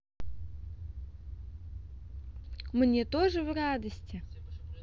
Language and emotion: Russian, positive